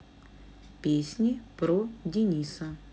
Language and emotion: Russian, neutral